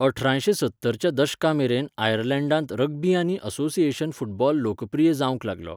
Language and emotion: Goan Konkani, neutral